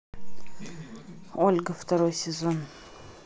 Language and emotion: Russian, neutral